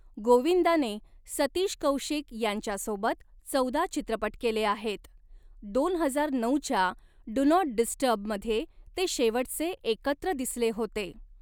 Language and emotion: Marathi, neutral